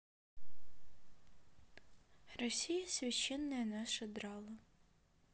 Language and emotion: Russian, sad